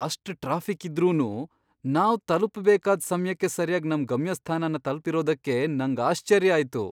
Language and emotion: Kannada, surprised